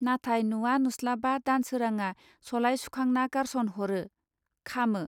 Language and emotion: Bodo, neutral